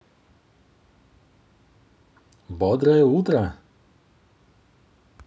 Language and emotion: Russian, positive